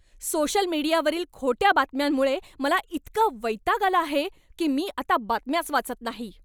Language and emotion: Marathi, angry